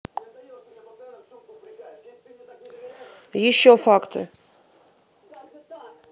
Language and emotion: Russian, angry